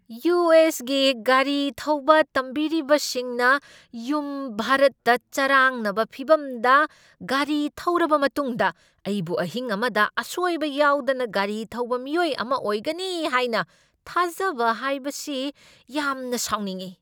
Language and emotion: Manipuri, angry